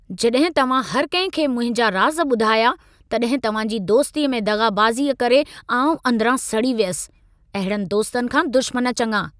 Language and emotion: Sindhi, angry